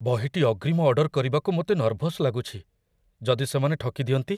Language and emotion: Odia, fearful